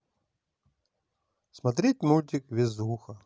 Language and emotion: Russian, positive